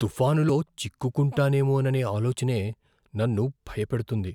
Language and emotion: Telugu, fearful